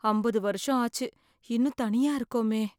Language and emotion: Tamil, fearful